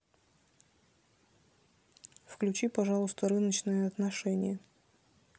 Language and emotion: Russian, neutral